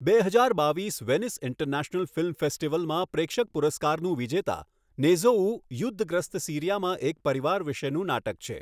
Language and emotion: Gujarati, neutral